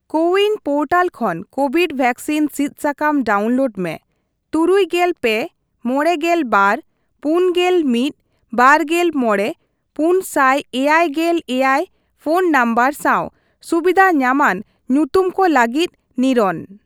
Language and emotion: Santali, neutral